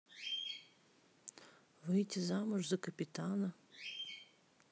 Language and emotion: Russian, neutral